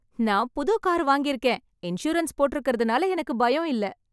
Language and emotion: Tamil, happy